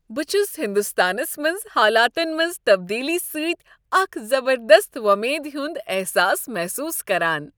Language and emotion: Kashmiri, happy